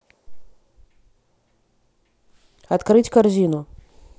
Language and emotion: Russian, neutral